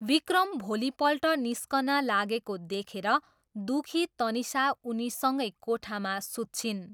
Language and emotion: Nepali, neutral